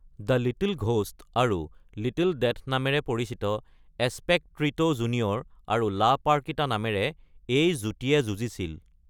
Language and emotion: Assamese, neutral